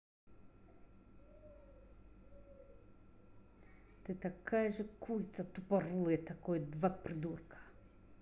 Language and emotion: Russian, angry